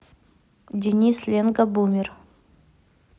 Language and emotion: Russian, neutral